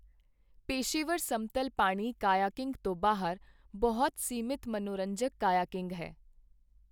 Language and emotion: Punjabi, neutral